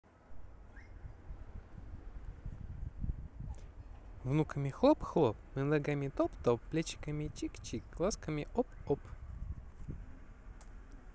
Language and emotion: Russian, neutral